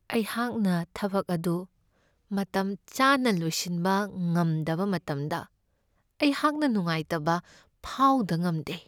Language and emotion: Manipuri, sad